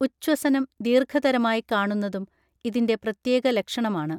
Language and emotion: Malayalam, neutral